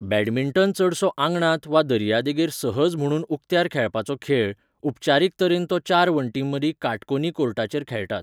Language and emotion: Goan Konkani, neutral